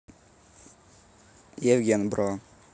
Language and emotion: Russian, neutral